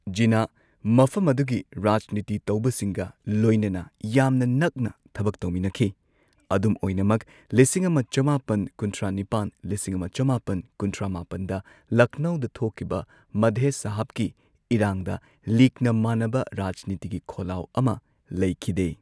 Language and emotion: Manipuri, neutral